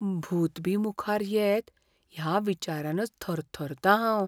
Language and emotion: Goan Konkani, fearful